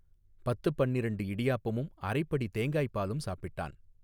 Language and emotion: Tamil, neutral